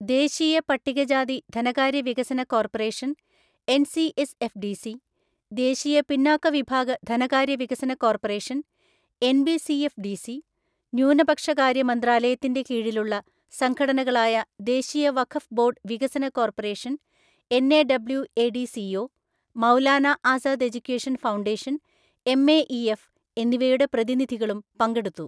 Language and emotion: Malayalam, neutral